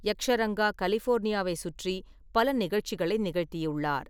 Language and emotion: Tamil, neutral